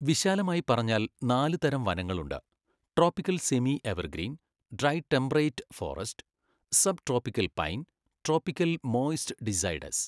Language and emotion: Malayalam, neutral